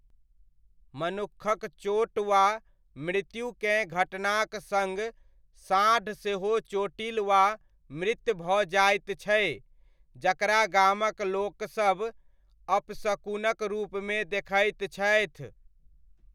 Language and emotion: Maithili, neutral